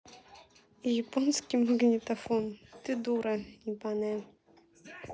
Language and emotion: Russian, neutral